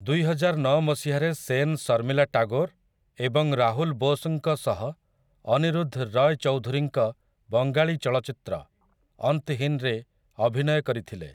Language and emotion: Odia, neutral